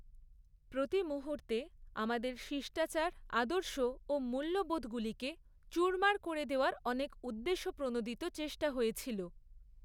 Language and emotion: Bengali, neutral